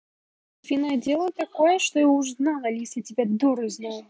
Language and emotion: Russian, angry